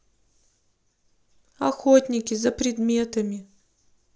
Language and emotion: Russian, sad